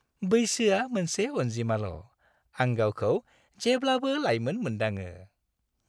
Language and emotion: Bodo, happy